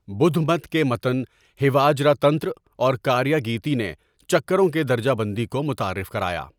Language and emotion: Urdu, neutral